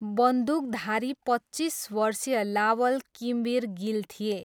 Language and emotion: Nepali, neutral